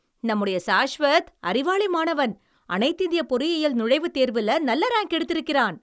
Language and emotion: Tamil, happy